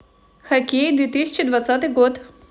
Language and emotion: Russian, positive